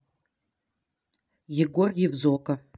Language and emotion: Russian, neutral